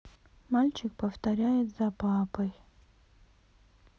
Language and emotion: Russian, sad